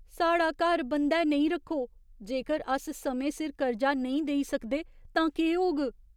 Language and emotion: Dogri, fearful